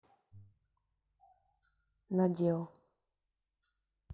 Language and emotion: Russian, neutral